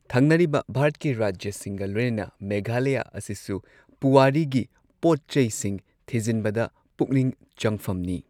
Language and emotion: Manipuri, neutral